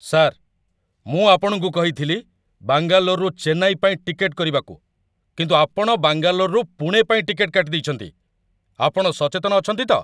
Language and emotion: Odia, angry